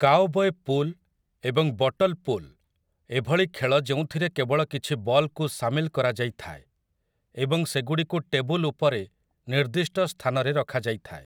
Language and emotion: Odia, neutral